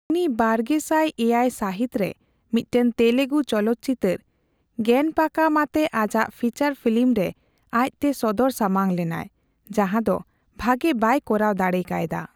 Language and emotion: Santali, neutral